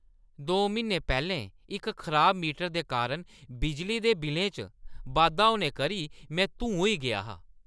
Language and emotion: Dogri, angry